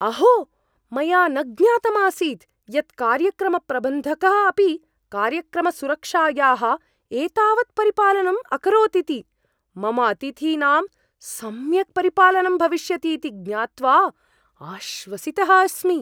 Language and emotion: Sanskrit, surprised